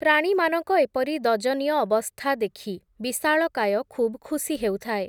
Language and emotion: Odia, neutral